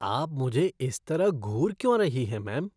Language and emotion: Hindi, disgusted